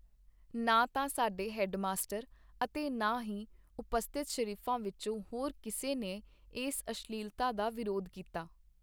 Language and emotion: Punjabi, neutral